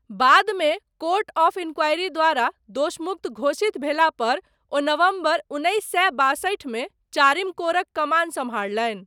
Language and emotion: Maithili, neutral